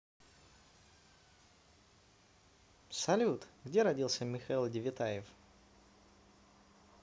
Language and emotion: Russian, positive